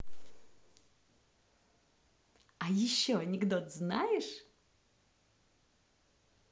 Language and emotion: Russian, positive